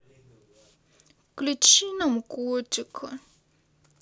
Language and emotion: Russian, sad